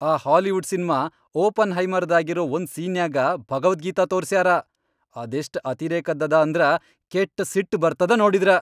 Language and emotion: Kannada, angry